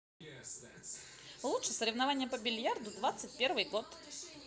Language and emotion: Russian, positive